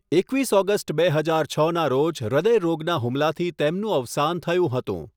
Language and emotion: Gujarati, neutral